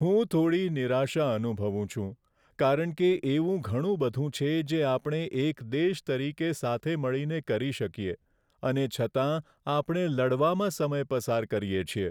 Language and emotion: Gujarati, sad